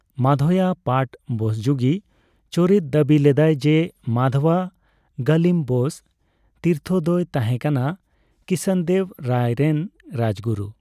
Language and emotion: Santali, neutral